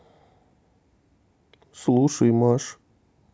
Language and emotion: Russian, neutral